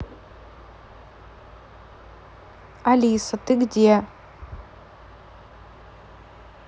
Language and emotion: Russian, neutral